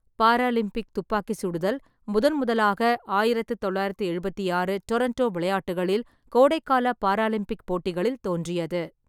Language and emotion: Tamil, neutral